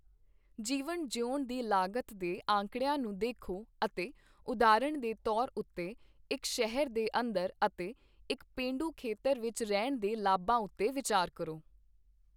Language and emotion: Punjabi, neutral